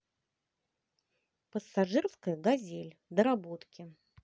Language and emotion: Russian, positive